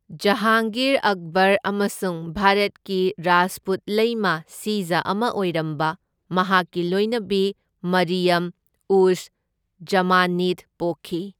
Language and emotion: Manipuri, neutral